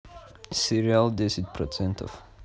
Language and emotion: Russian, neutral